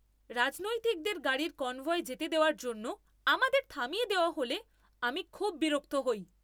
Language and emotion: Bengali, angry